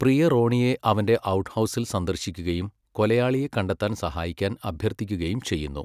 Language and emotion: Malayalam, neutral